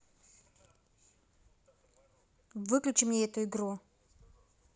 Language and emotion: Russian, neutral